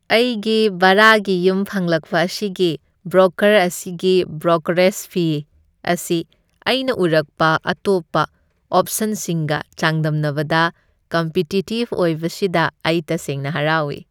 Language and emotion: Manipuri, happy